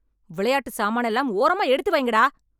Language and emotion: Tamil, angry